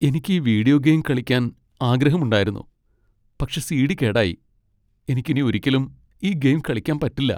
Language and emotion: Malayalam, sad